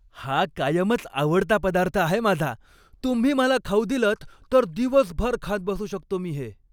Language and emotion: Marathi, happy